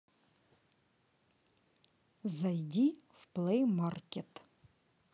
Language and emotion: Russian, neutral